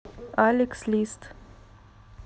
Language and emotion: Russian, neutral